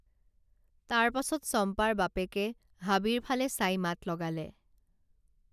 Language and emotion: Assamese, neutral